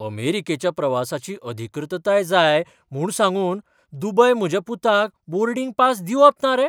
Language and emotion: Goan Konkani, surprised